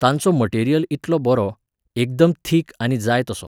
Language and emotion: Goan Konkani, neutral